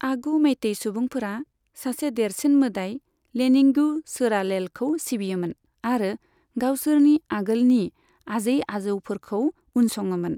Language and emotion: Bodo, neutral